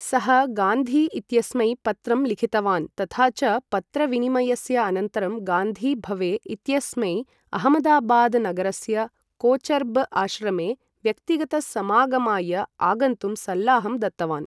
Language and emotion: Sanskrit, neutral